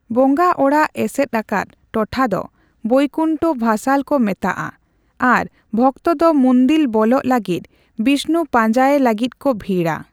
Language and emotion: Santali, neutral